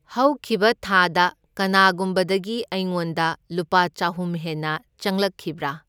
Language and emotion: Manipuri, neutral